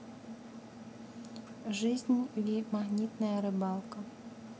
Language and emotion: Russian, neutral